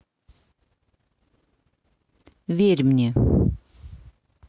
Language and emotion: Russian, neutral